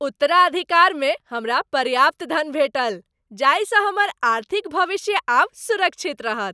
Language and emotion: Maithili, happy